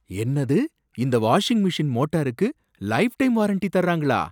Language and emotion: Tamil, surprised